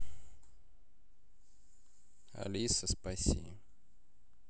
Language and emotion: Russian, neutral